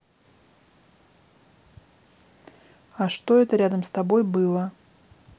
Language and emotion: Russian, neutral